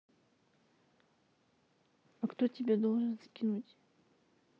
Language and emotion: Russian, neutral